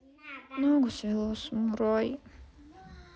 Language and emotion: Russian, sad